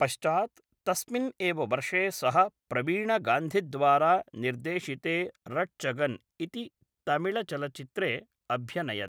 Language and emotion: Sanskrit, neutral